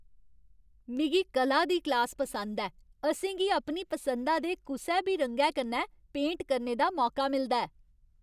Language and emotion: Dogri, happy